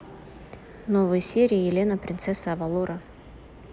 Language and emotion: Russian, neutral